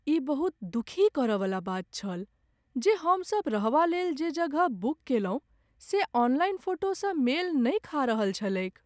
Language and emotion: Maithili, sad